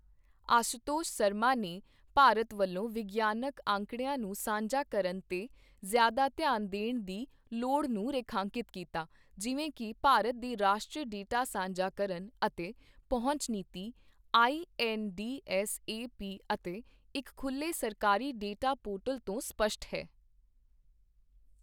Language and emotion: Punjabi, neutral